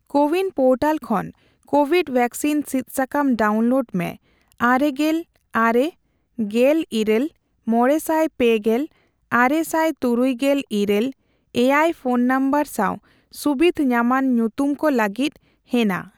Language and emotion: Santali, neutral